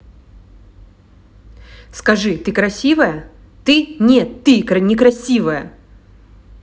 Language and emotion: Russian, angry